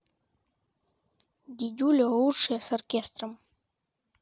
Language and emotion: Russian, neutral